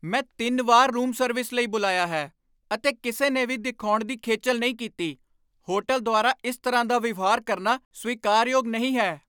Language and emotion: Punjabi, angry